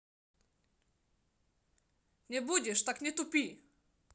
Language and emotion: Russian, angry